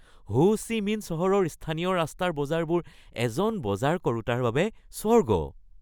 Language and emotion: Assamese, happy